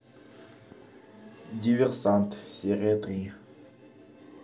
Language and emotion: Russian, neutral